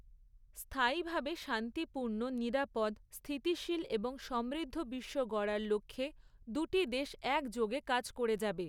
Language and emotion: Bengali, neutral